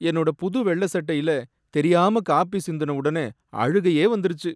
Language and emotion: Tamil, sad